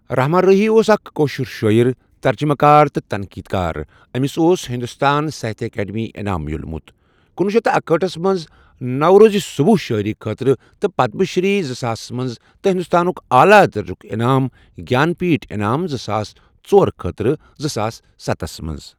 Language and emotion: Kashmiri, neutral